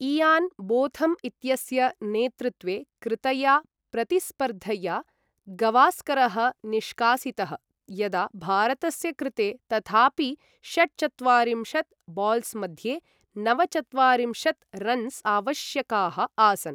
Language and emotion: Sanskrit, neutral